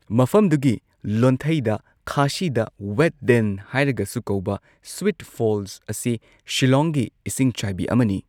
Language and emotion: Manipuri, neutral